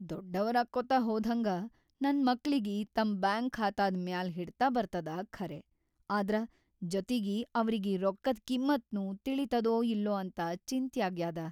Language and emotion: Kannada, fearful